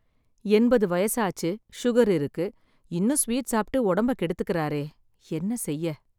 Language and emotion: Tamil, sad